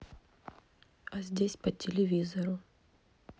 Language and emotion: Russian, neutral